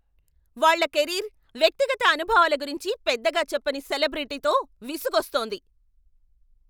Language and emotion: Telugu, angry